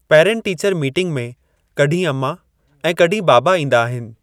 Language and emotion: Sindhi, neutral